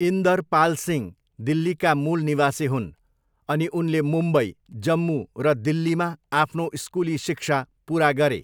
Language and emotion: Nepali, neutral